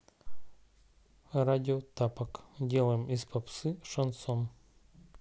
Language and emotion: Russian, neutral